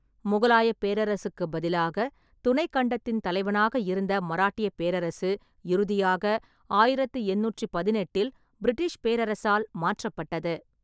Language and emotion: Tamil, neutral